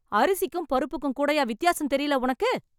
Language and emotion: Tamil, angry